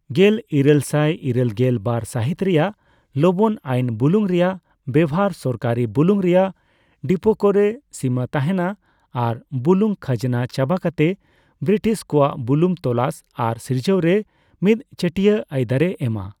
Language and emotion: Santali, neutral